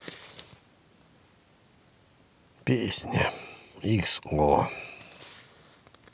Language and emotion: Russian, sad